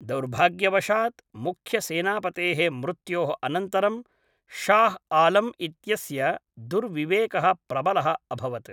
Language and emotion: Sanskrit, neutral